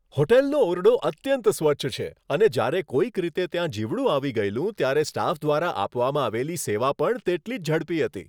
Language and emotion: Gujarati, happy